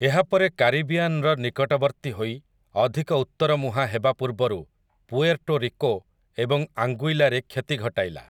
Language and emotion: Odia, neutral